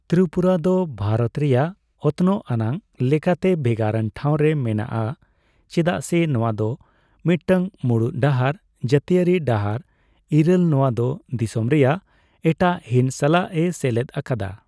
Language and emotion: Santali, neutral